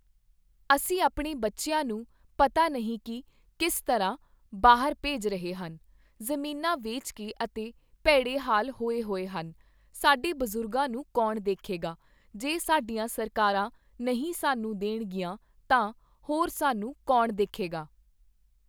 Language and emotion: Punjabi, neutral